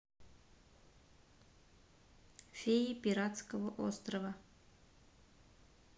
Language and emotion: Russian, neutral